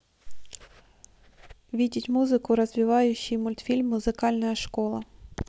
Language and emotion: Russian, neutral